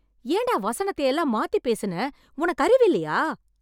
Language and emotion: Tamil, angry